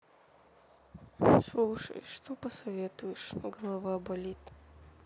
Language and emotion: Russian, sad